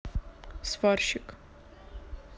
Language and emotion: Russian, neutral